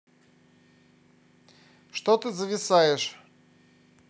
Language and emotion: Russian, angry